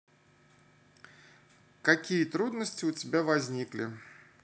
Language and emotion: Russian, neutral